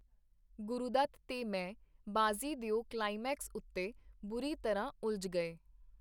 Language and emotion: Punjabi, neutral